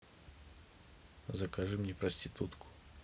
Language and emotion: Russian, neutral